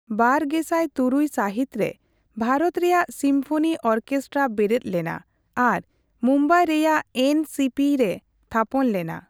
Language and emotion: Santali, neutral